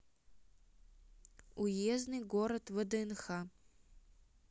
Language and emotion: Russian, neutral